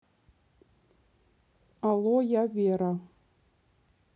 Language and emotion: Russian, neutral